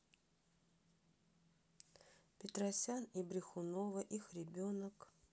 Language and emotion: Russian, neutral